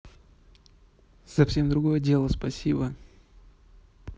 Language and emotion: Russian, neutral